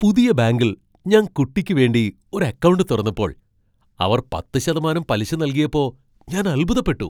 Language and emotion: Malayalam, surprised